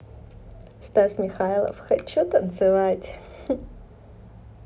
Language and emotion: Russian, positive